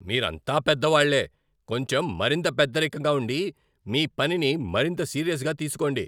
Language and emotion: Telugu, angry